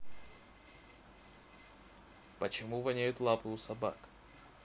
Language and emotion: Russian, neutral